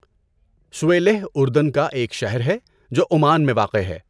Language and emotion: Urdu, neutral